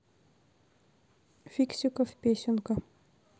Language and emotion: Russian, neutral